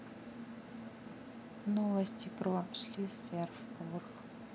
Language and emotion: Russian, neutral